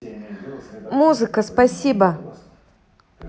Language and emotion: Russian, neutral